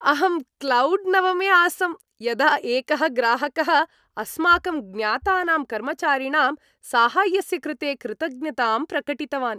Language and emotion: Sanskrit, happy